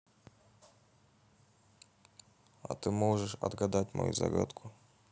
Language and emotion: Russian, neutral